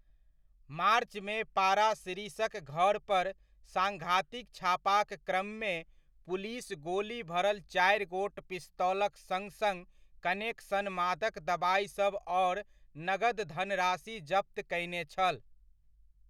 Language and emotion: Maithili, neutral